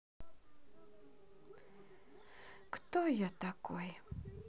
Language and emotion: Russian, sad